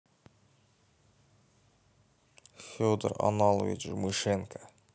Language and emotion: Russian, neutral